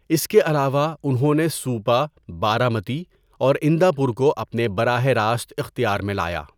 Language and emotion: Urdu, neutral